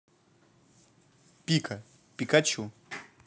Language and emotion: Russian, neutral